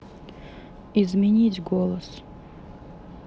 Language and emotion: Russian, neutral